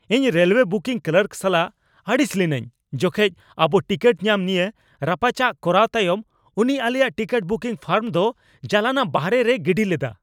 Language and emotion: Santali, angry